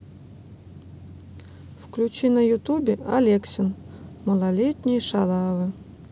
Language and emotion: Russian, neutral